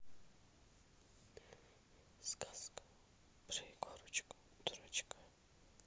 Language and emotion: Russian, neutral